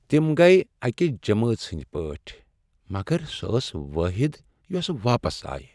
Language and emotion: Kashmiri, sad